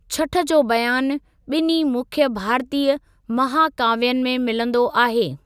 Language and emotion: Sindhi, neutral